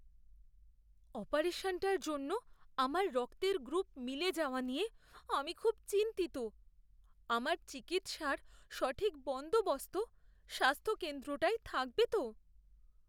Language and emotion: Bengali, fearful